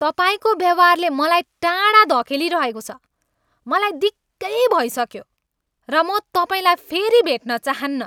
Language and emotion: Nepali, angry